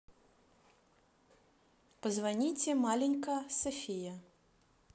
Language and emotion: Russian, neutral